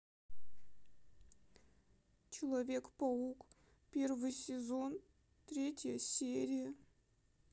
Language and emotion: Russian, sad